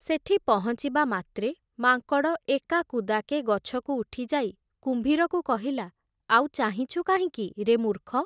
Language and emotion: Odia, neutral